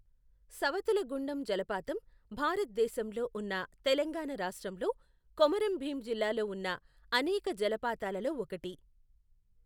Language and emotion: Telugu, neutral